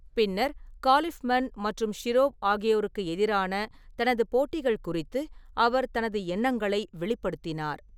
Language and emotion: Tamil, neutral